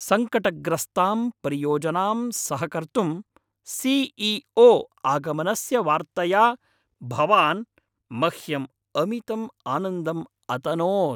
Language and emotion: Sanskrit, happy